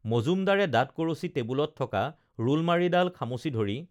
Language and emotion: Assamese, neutral